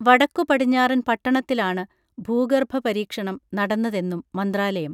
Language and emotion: Malayalam, neutral